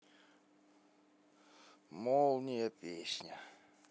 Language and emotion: Russian, sad